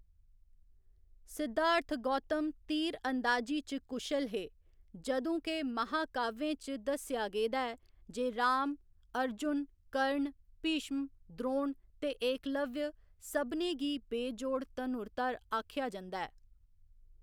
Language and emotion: Dogri, neutral